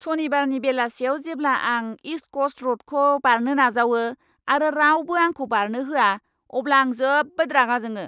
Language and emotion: Bodo, angry